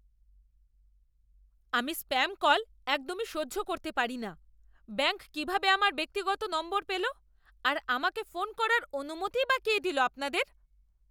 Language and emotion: Bengali, angry